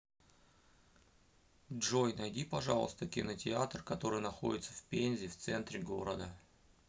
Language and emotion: Russian, neutral